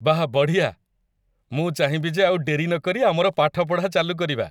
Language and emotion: Odia, happy